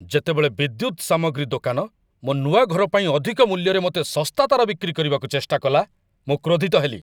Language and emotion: Odia, angry